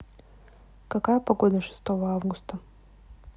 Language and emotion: Russian, neutral